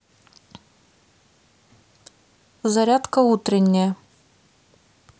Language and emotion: Russian, neutral